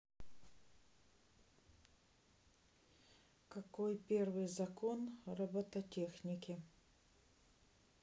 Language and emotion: Russian, neutral